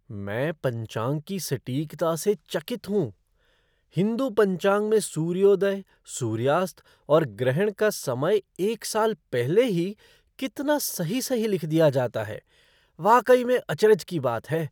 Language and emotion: Hindi, surprised